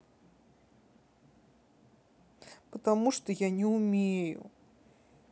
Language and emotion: Russian, sad